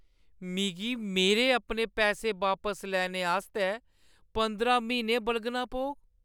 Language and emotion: Dogri, sad